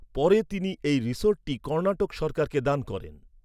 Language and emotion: Bengali, neutral